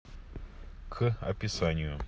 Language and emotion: Russian, neutral